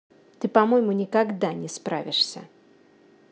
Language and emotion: Russian, angry